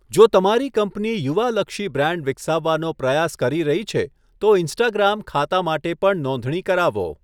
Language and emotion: Gujarati, neutral